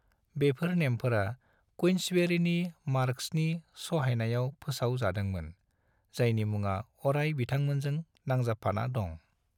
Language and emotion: Bodo, neutral